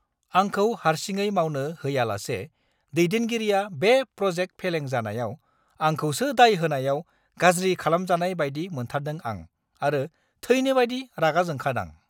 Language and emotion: Bodo, angry